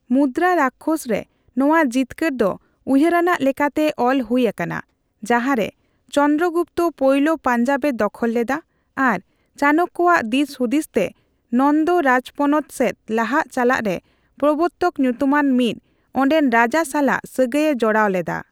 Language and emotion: Santali, neutral